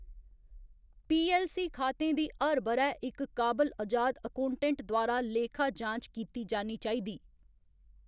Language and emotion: Dogri, neutral